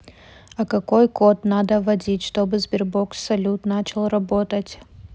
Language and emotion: Russian, neutral